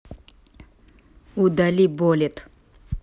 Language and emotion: Russian, neutral